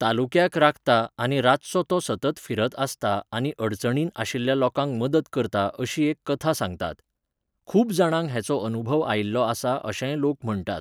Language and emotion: Goan Konkani, neutral